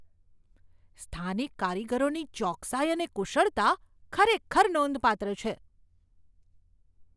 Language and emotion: Gujarati, surprised